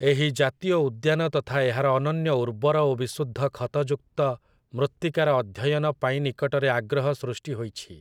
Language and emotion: Odia, neutral